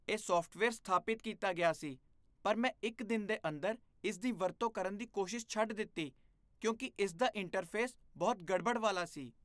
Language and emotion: Punjabi, disgusted